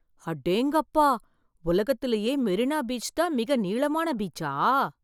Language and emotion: Tamil, surprised